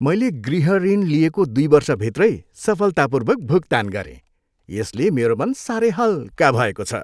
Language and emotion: Nepali, happy